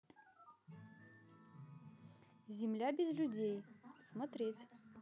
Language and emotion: Russian, positive